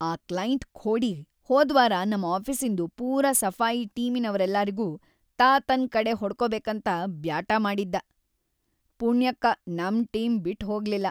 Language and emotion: Kannada, angry